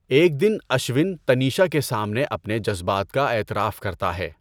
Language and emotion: Urdu, neutral